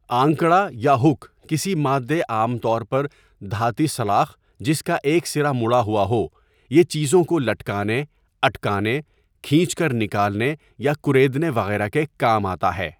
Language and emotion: Urdu, neutral